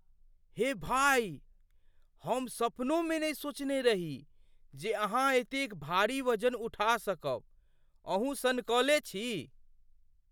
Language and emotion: Maithili, surprised